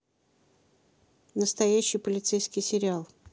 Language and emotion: Russian, neutral